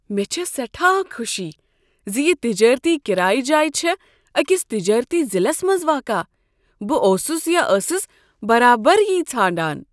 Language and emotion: Kashmiri, surprised